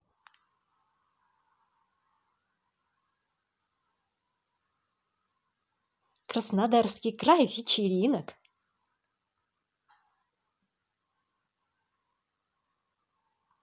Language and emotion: Russian, positive